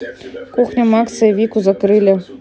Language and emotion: Russian, neutral